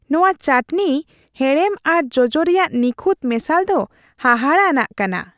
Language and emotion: Santali, happy